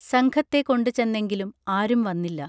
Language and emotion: Malayalam, neutral